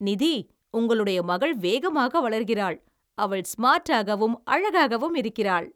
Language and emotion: Tamil, happy